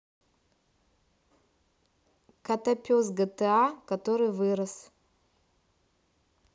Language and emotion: Russian, neutral